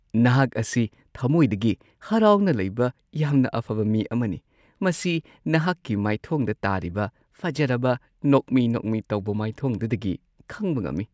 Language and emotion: Manipuri, happy